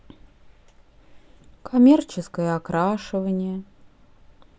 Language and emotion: Russian, sad